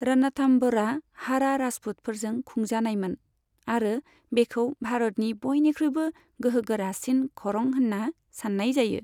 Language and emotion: Bodo, neutral